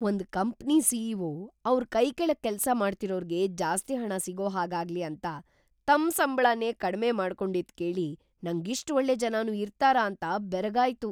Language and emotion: Kannada, surprised